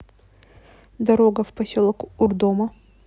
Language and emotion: Russian, neutral